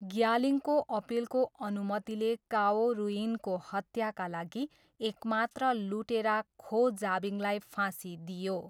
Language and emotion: Nepali, neutral